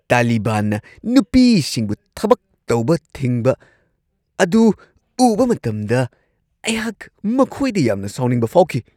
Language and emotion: Manipuri, angry